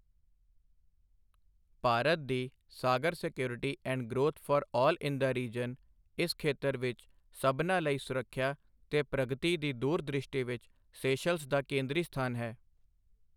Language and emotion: Punjabi, neutral